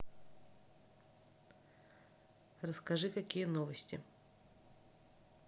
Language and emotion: Russian, neutral